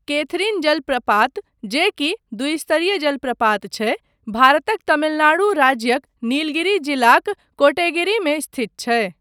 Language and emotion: Maithili, neutral